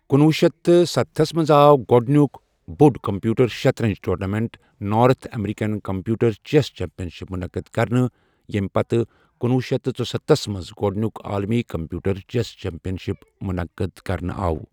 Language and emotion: Kashmiri, neutral